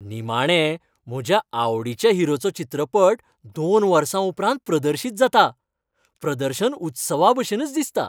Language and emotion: Goan Konkani, happy